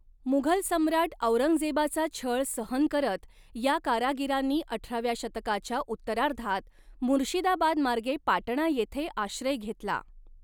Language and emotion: Marathi, neutral